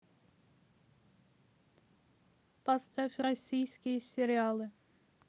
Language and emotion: Russian, neutral